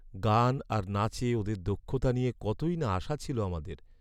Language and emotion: Bengali, sad